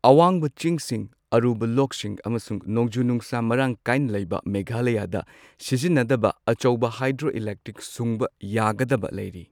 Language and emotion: Manipuri, neutral